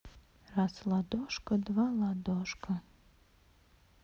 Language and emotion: Russian, neutral